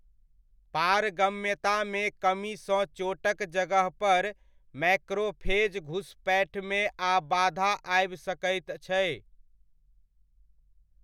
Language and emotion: Maithili, neutral